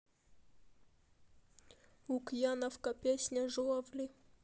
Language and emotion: Russian, neutral